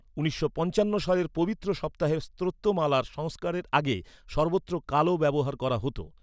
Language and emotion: Bengali, neutral